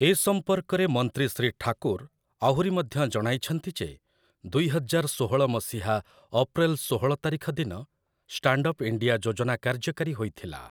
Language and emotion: Odia, neutral